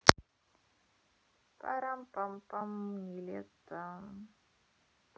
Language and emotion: Russian, positive